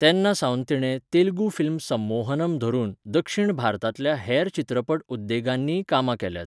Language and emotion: Goan Konkani, neutral